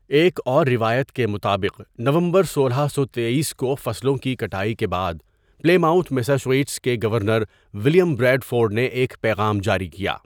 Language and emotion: Urdu, neutral